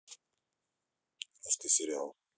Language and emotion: Russian, neutral